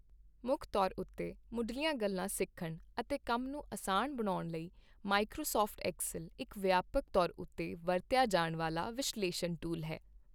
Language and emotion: Punjabi, neutral